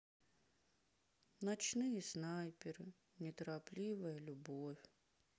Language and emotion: Russian, sad